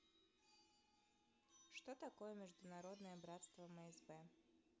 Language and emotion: Russian, neutral